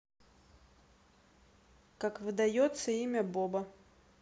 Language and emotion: Russian, neutral